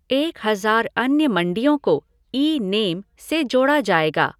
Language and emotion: Hindi, neutral